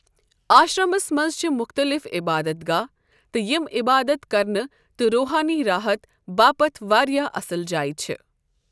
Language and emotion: Kashmiri, neutral